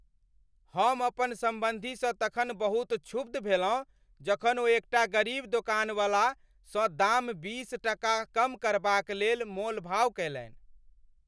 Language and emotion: Maithili, angry